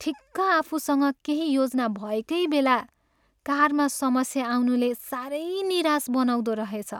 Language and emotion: Nepali, sad